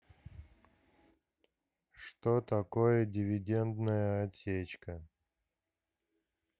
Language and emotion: Russian, neutral